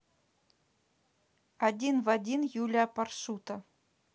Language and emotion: Russian, neutral